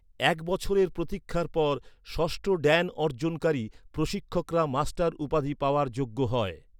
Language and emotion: Bengali, neutral